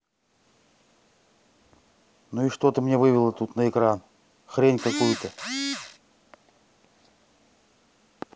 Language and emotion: Russian, angry